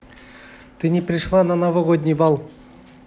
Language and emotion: Russian, neutral